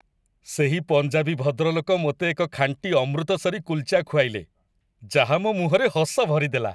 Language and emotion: Odia, happy